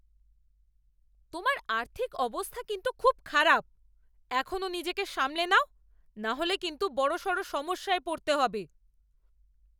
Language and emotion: Bengali, angry